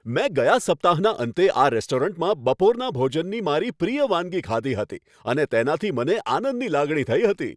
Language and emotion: Gujarati, happy